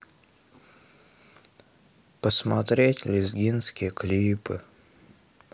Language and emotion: Russian, sad